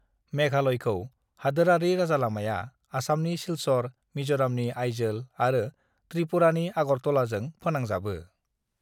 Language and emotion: Bodo, neutral